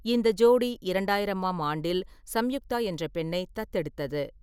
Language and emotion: Tamil, neutral